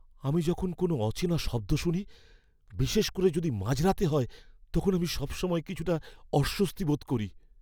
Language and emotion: Bengali, fearful